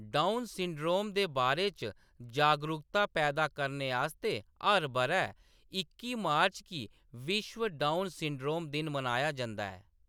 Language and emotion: Dogri, neutral